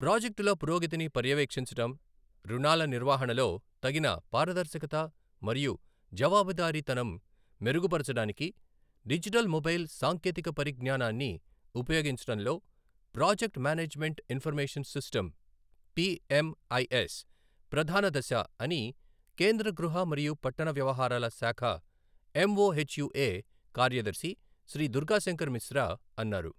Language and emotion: Telugu, neutral